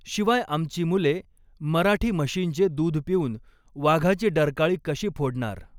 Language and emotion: Marathi, neutral